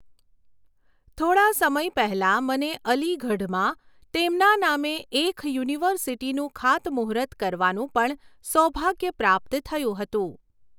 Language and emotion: Gujarati, neutral